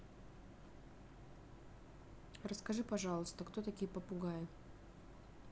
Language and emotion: Russian, neutral